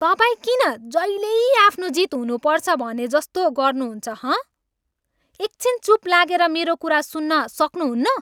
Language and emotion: Nepali, angry